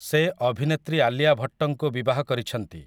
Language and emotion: Odia, neutral